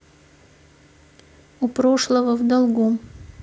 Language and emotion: Russian, neutral